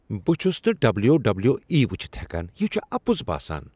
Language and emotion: Kashmiri, disgusted